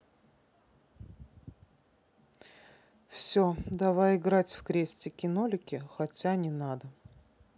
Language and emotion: Russian, neutral